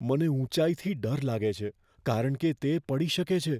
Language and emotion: Gujarati, fearful